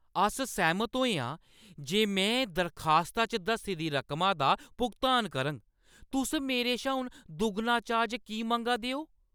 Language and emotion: Dogri, angry